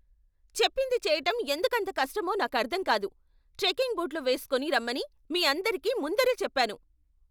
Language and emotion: Telugu, angry